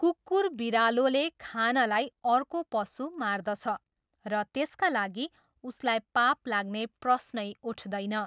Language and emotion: Nepali, neutral